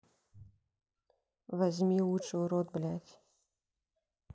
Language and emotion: Russian, neutral